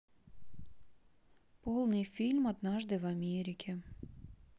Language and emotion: Russian, neutral